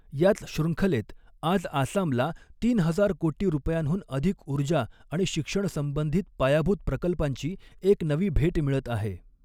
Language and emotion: Marathi, neutral